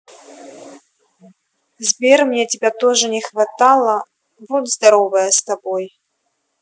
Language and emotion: Russian, neutral